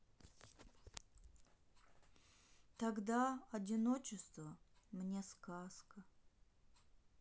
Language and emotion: Russian, sad